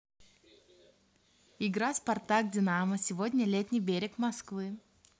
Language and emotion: Russian, positive